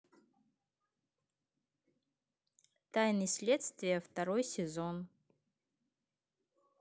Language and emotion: Russian, neutral